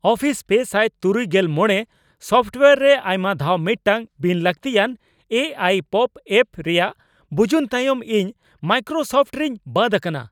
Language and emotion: Santali, angry